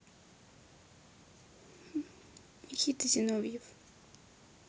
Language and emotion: Russian, neutral